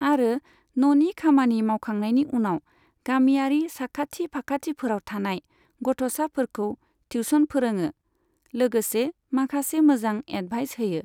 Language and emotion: Bodo, neutral